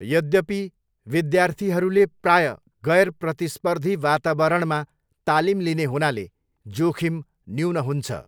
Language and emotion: Nepali, neutral